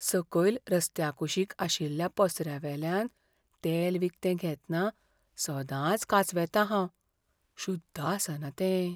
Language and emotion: Goan Konkani, fearful